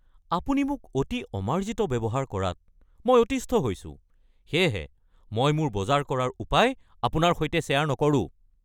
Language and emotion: Assamese, angry